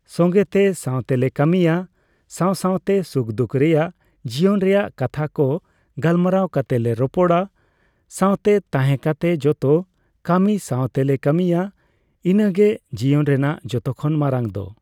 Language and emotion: Santali, neutral